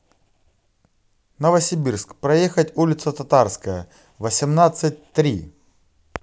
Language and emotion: Russian, positive